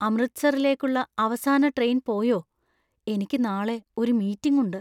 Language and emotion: Malayalam, fearful